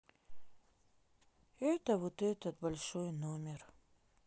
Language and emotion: Russian, sad